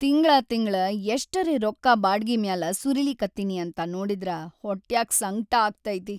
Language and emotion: Kannada, sad